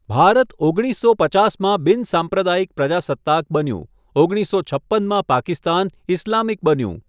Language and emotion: Gujarati, neutral